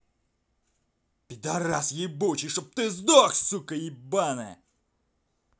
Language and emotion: Russian, angry